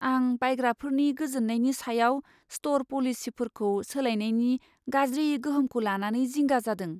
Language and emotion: Bodo, fearful